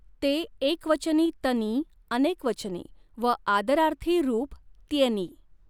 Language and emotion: Marathi, neutral